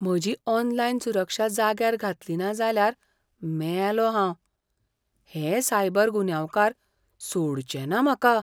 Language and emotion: Goan Konkani, fearful